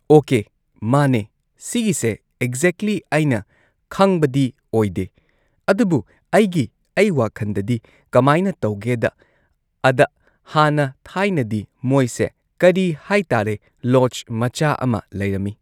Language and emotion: Manipuri, neutral